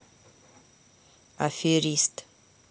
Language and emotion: Russian, neutral